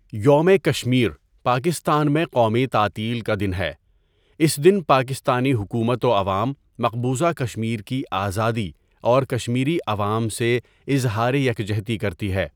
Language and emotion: Urdu, neutral